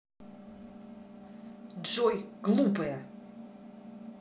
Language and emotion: Russian, angry